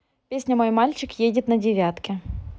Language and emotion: Russian, neutral